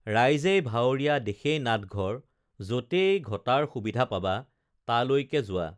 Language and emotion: Assamese, neutral